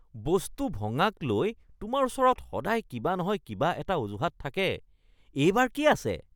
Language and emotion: Assamese, disgusted